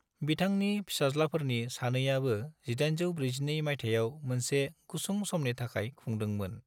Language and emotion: Bodo, neutral